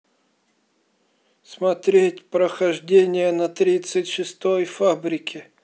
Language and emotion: Russian, sad